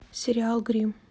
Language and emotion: Russian, neutral